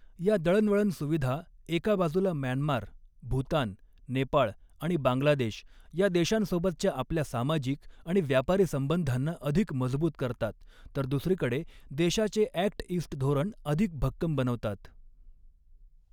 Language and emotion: Marathi, neutral